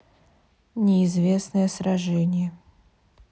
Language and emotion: Russian, neutral